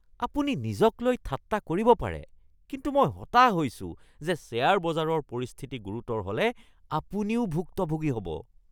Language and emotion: Assamese, disgusted